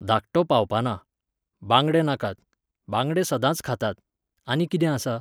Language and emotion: Goan Konkani, neutral